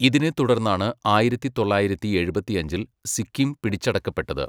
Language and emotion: Malayalam, neutral